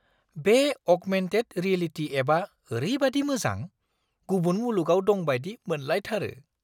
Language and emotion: Bodo, surprised